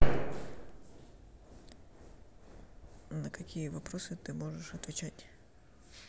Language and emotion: Russian, neutral